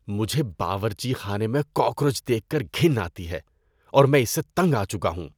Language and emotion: Urdu, disgusted